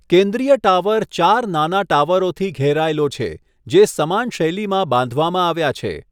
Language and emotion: Gujarati, neutral